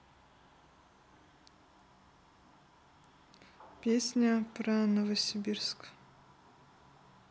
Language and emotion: Russian, neutral